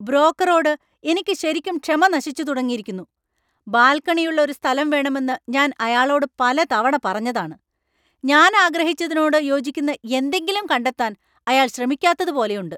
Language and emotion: Malayalam, angry